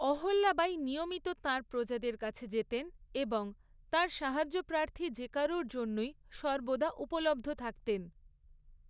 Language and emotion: Bengali, neutral